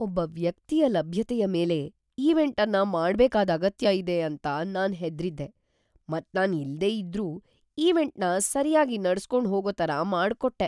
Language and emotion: Kannada, fearful